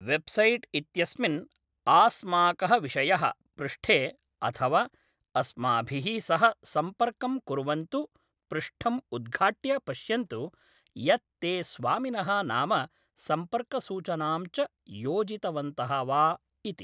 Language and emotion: Sanskrit, neutral